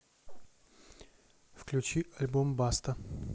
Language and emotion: Russian, neutral